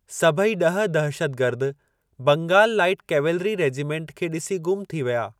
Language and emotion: Sindhi, neutral